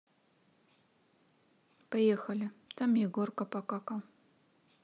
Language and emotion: Russian, neutral